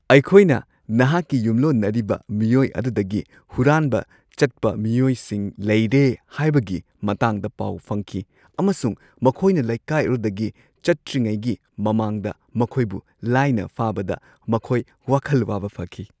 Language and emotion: Manipuri, happy